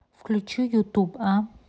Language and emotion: Russian, neutral